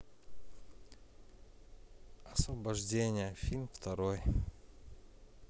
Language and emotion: Russian, neutral